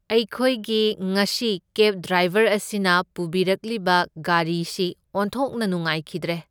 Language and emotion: Manipuri, neutral